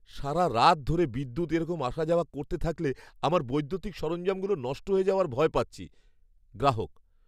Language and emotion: Bengali, fearful